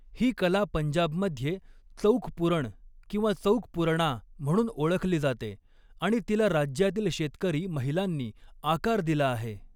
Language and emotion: Marathi, neutral